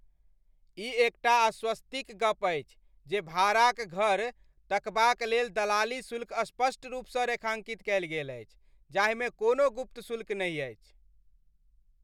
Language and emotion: Maithili, happy